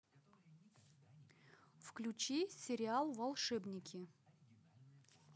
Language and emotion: Russian, neutral